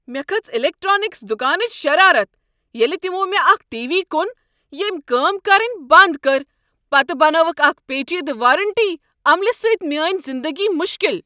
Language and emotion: Kashmiri, angry